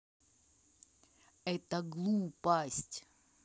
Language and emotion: Russian, neutral